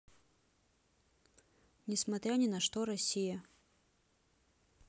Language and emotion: Russian, neutral